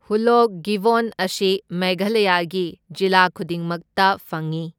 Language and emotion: Manipuri, neutral